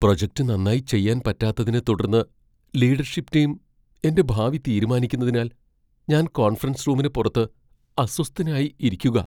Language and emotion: Malayalam, fearful